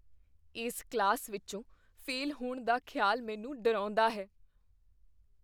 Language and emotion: Punjabi, fearful